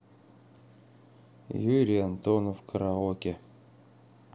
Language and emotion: Russian, neutral